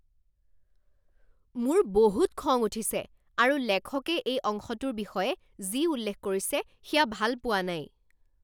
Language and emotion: Assamese, angry